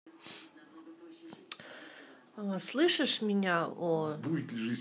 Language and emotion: Russian, neutral